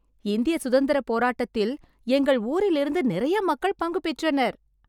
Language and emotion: Tamil, happy